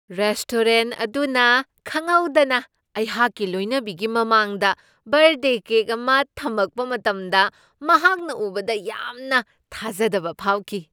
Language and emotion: Manipuri, surprised